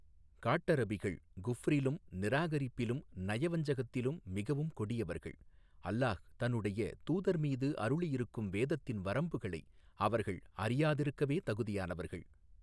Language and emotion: Tamil, neutral